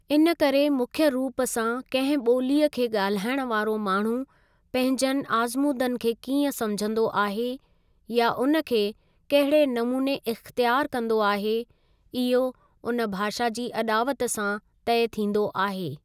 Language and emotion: Sindhi, neutral